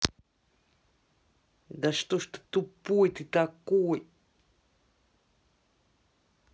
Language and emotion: Russian, angry